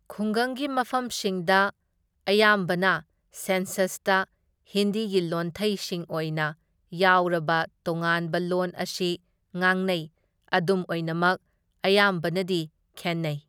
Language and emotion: Manipuri, neutral